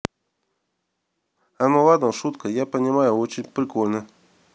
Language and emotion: Russian, neutral